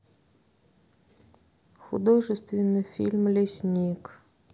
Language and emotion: Russian, neutral